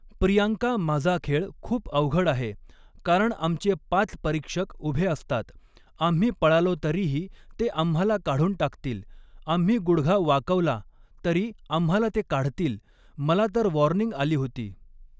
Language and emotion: Marathi, neutral